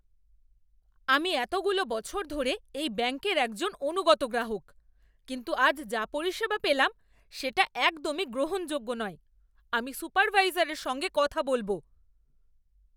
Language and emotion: Bengali, angry